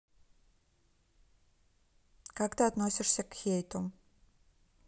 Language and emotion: Russian, neutral